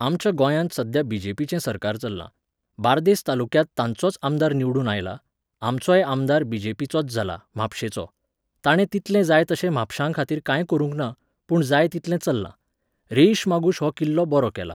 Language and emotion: Goan Konkani, neutral